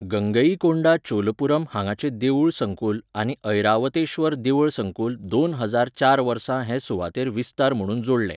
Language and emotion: Goan Konkani, neutral